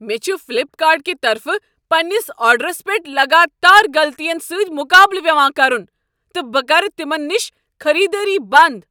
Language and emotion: Kashmiri, angry